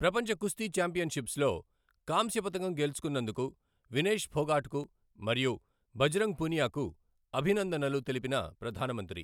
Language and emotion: Telugu, neutral